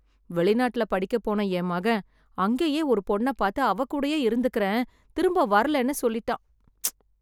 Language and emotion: Tamil, sad